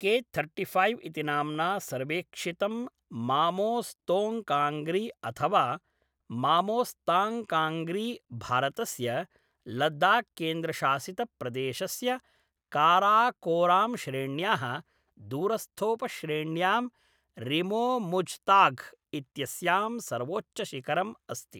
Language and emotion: Sanskrit, neutral